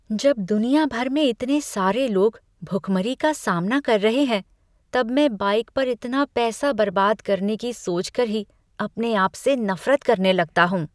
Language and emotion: Hindi, disgusted